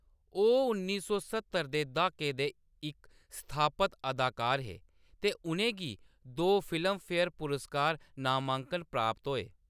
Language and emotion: Dogri, neutral